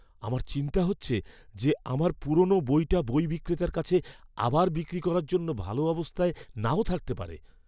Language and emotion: Bengali, fearful